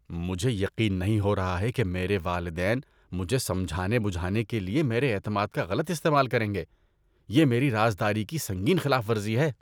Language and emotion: Urdu, disgusted